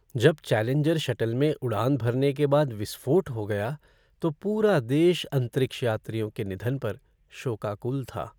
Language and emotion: Hindi, sad